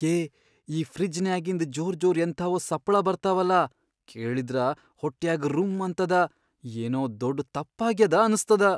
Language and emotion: Kannada, fearful